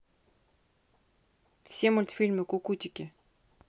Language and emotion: Russian, neutral